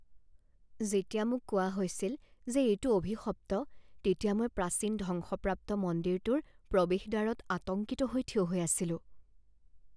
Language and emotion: Assamese, fearful